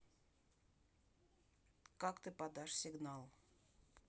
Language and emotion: Russian, neutral